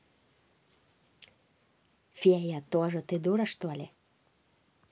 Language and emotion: Russian, angry